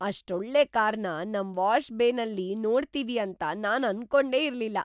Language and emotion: Kannada, surprised